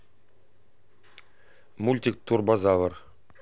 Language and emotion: Russian, neutral